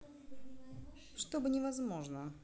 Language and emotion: Russian, neutral